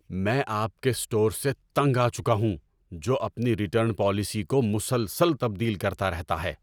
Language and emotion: Urdu, angry